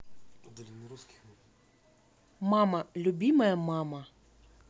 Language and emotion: Russian, neutral